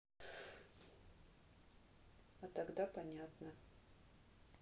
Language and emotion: Russian, neutral